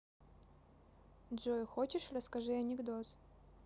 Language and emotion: Russian, neutral